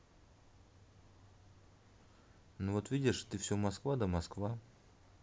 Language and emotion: Russian, neutral